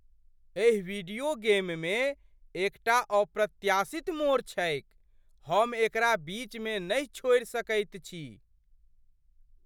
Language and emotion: Maithili, surprised